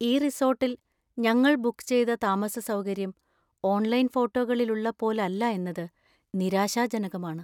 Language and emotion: Malayalam, sad